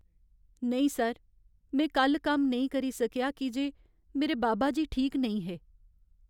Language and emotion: Dogri, sad